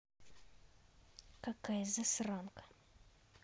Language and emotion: Russian, angry